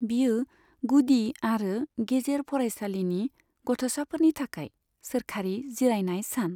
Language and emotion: Bodo, neutral